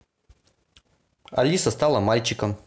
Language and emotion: Russian, neutral